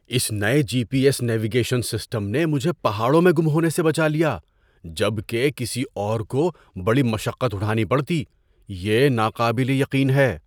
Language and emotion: Urdu, surprised